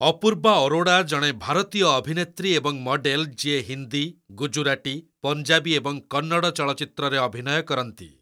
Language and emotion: Odia, neutral